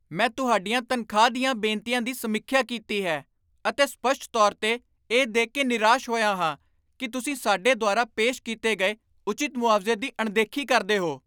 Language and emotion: Punjabi, angry